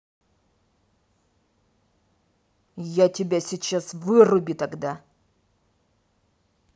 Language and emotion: Russian, angry